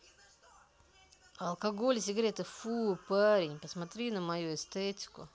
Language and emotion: Russian, angry